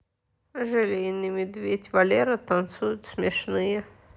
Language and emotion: Russian, neutral